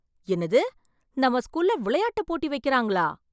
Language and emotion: Tamil, surprised